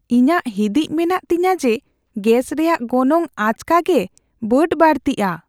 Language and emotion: Santali, fearful